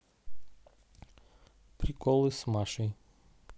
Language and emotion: Russian, neutral